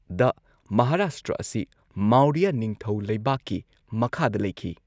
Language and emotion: Manipuri, neutral